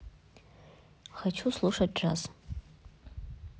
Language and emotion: Russian, neutral